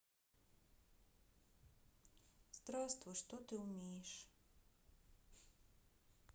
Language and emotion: Russian, sad